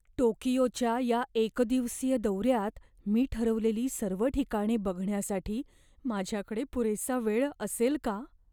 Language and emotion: Marathi, fearful